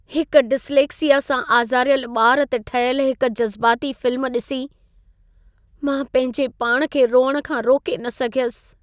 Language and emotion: Sindhi, sad